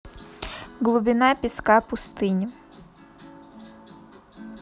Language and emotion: Russian, neutral